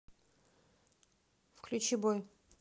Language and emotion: Russian, neutral